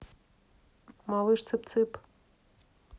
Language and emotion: Russian, neutral